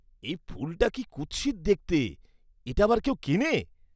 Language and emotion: Bengali, disgusted